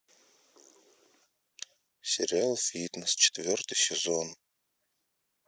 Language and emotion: Russian, sad